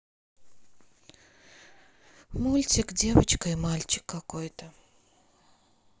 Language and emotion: Russian, sad